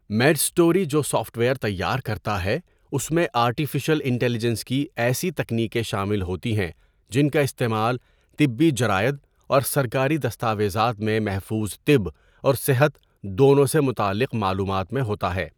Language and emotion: Urdu, neutral